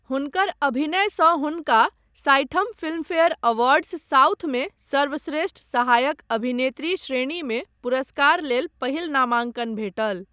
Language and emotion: Maithili, neutral